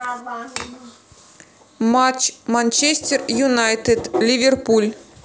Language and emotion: Russian, neutral